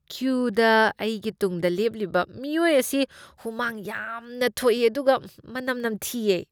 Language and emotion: Manipuri, disgusted